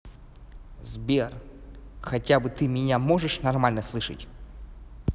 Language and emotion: Russian, angry